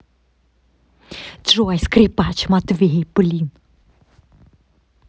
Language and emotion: Russian, angry